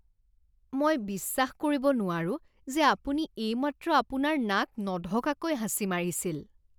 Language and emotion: Assamese, disgusted